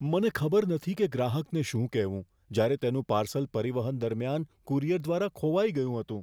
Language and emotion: Gujarati, fearful